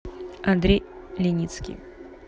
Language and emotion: Russian, neutral